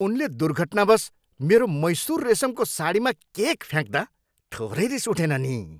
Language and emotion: Nepali, angry